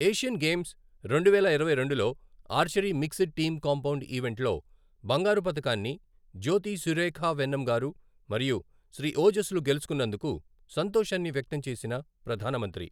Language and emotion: Telugu, neutral